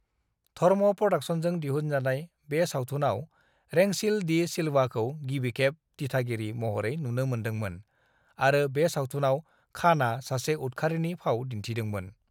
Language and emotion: Bodo, neutral